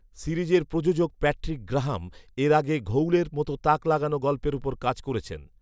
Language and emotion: Bengali, neutral